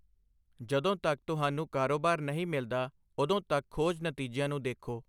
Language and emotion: Punjabi, neutral